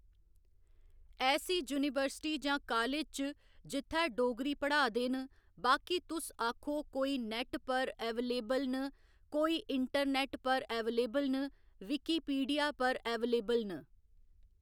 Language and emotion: Dogri, neutral